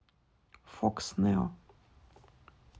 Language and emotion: Russian, neutral